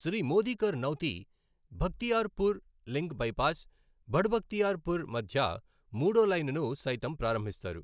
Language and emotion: Telugu, neutral